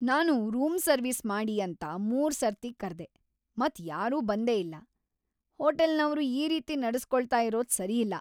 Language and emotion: Kannada, angry